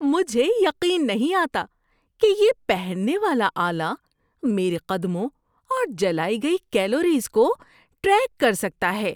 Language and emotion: Urdu, surprised